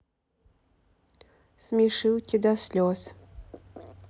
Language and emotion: Russian, neutral